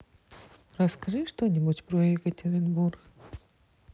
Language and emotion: Russian, neutral